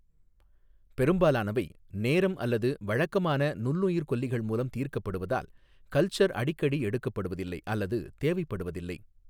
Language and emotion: Tamil, neutral